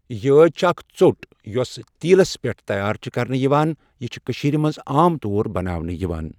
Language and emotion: Kashmiri, neutral